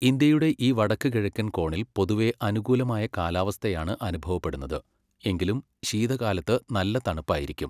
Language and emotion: Malayalam, neutral